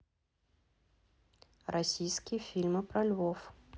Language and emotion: Russian, neutral